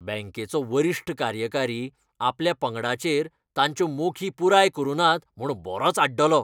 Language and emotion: Goan Konkani, angry